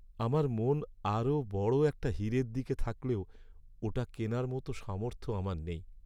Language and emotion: Bengali, sad